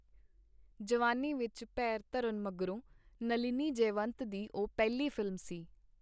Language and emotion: Punjabi, neutral